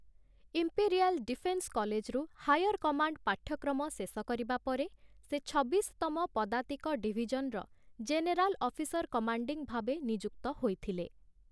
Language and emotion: Odia, neutral